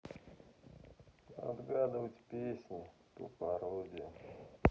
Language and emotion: Russian, sad